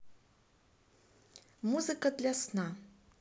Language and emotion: Russian, neutral